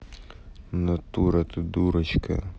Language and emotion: Russian, angry